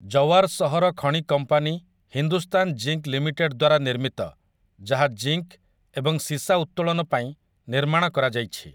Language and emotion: Odia, neutral